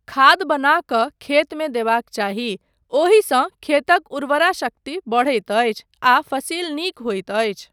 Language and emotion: Maithili, neutral